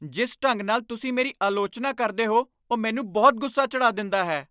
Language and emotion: Punjabi, angry